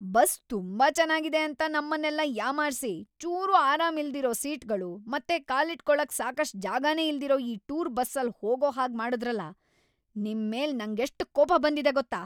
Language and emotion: Kannada, angry